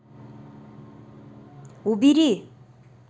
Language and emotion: Russian, angry